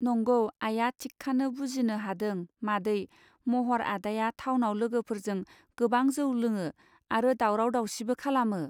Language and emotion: Bodo, neutral